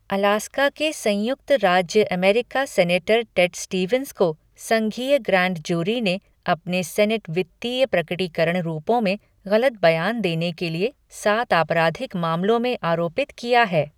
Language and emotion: Hindi, neutral